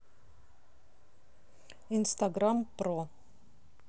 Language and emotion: Russian, neutral